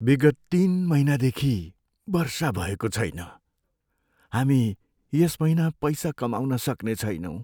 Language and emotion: Nepali, sad